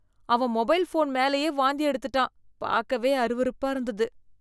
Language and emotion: Tamil, disgusted